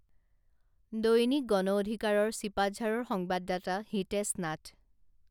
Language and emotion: Assamese, neutral